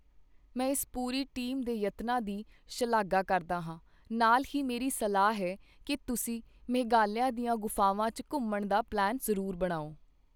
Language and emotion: Punjabi, neutral